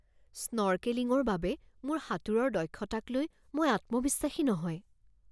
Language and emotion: Assamese, fearful